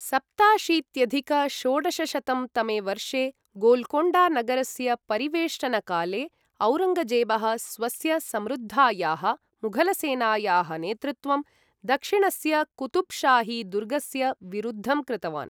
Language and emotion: Sanskrit, neutral